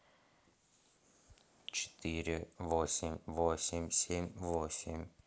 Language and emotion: Russian, neutral